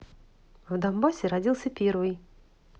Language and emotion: Russian, neutral